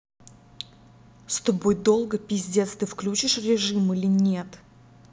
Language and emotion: Russian, angry